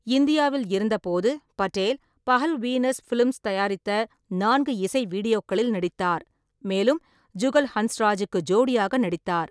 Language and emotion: Tamil, neutral